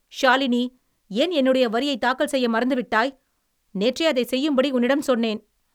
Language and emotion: Tamil, angry